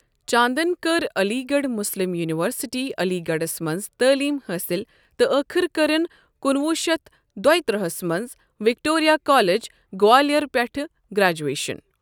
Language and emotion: Kashmiri, neutral